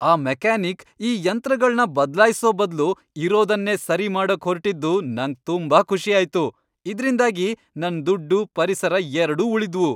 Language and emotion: Kannada, happy